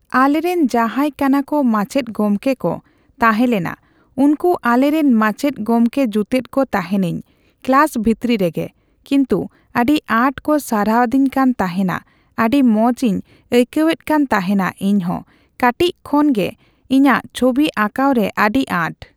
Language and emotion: Santali, neutral